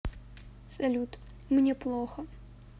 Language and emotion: Russian, sad